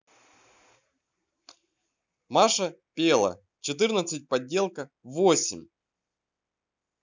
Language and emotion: Russian, neutral